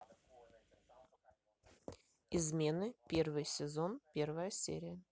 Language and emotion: Russian, neutral